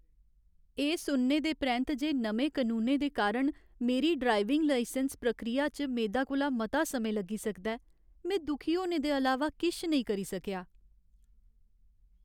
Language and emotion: Dogri, sad